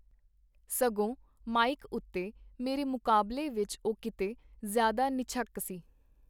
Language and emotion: Punjabi, neutral